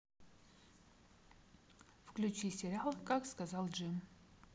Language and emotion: Russian, neutral